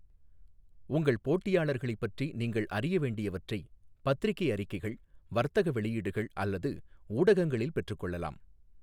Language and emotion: Tamil, neutral